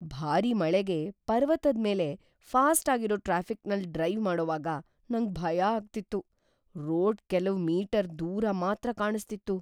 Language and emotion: Kannada, fearful